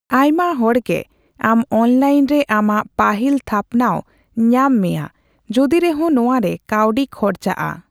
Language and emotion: Santali, neutral